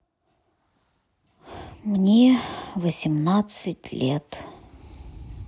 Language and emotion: Russian, sad